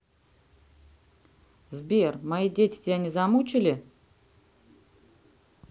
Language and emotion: Russian, neutral